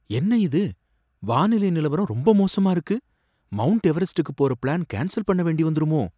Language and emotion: Tamil, fearful